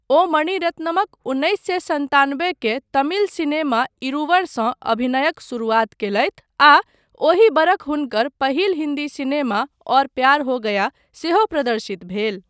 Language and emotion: Maithili, neutral